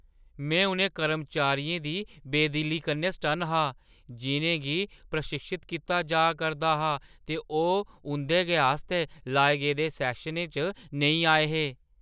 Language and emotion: Dogri, surprised